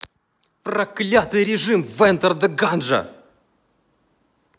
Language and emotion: Russian, angry